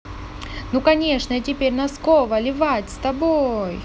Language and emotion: Russian, positive